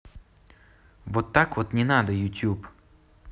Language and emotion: Russian, neutral